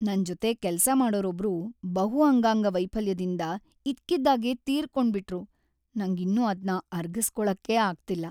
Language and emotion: Kannada, sad